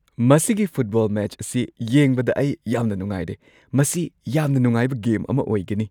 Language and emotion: Manipuri, happy